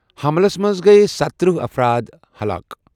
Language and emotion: Kashmiri, neutral